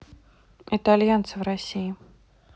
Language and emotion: Russian, neutral